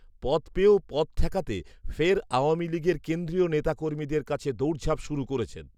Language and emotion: Bengali, neutral